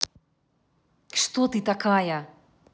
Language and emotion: Russian, angry